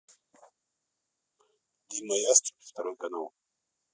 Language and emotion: Russian, neutral